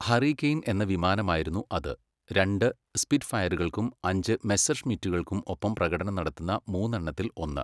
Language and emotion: Malayalam, neutral